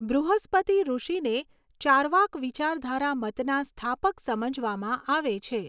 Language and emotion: Gujarati, neutral